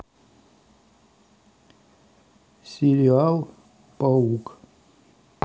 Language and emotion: Russian, neutral